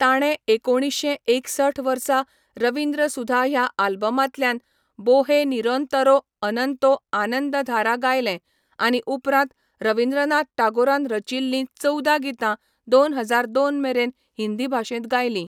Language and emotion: Goan Konkani, neutral